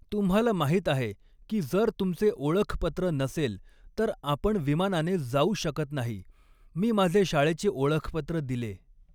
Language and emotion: Marathi, neutral